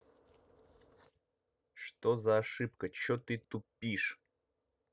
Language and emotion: Russian, angry